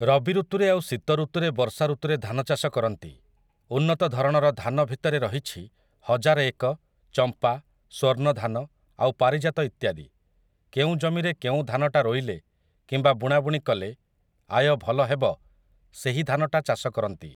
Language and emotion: Odia, neutral